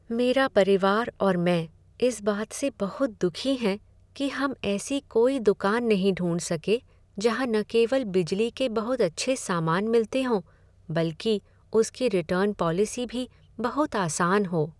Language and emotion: Hindi, sad